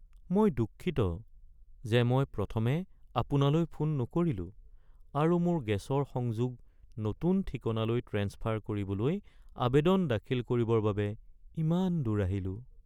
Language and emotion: Assamese, sad